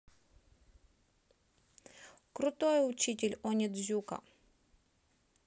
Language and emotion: Russian, neutral